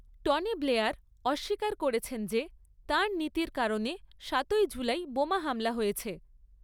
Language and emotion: Bengali, neutral